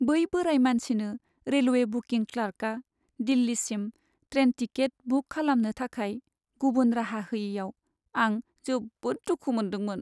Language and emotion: Bodo, sad